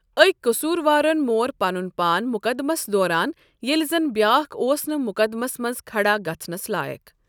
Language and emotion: Kashmiri, neutral